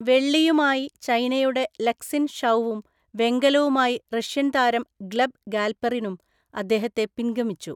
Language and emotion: Malayalam, neutral